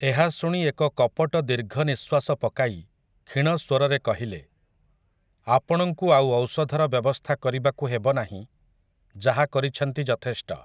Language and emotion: Odia, neutral